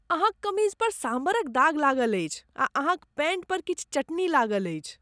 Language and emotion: Maithili, disgusted